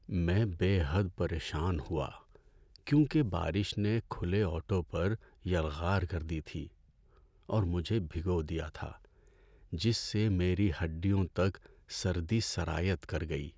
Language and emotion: Urdu, sad